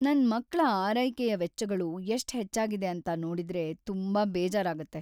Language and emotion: Kannada, sad